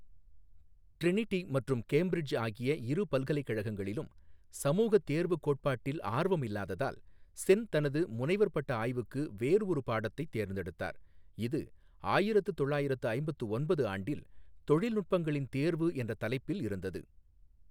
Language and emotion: Tamil, neutral